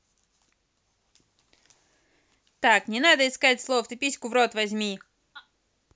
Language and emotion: Russian, angry